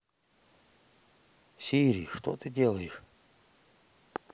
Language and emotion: Russian, neutral